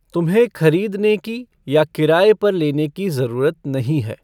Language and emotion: Hindi, neutral